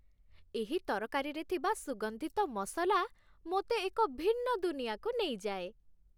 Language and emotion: Odia, happy